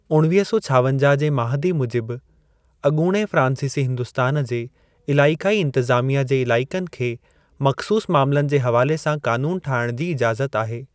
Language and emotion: Sindhi, neutral